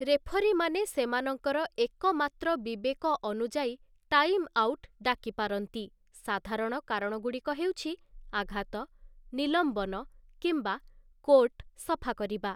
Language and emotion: Odia, neutral